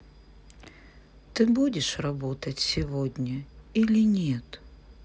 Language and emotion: Russian, sad